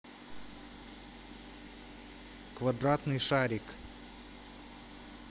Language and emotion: Russian, neutral